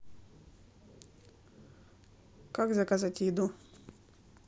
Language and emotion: Russian, neutral